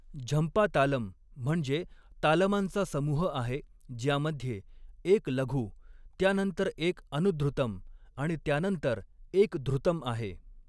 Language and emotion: Marathi, neutral